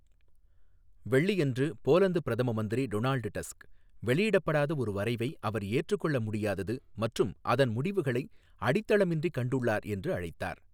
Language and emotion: Tamil, neutral